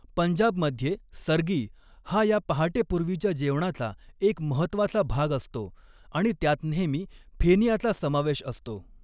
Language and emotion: Marathi, neutral